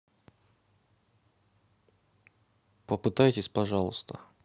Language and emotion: Russian, neutral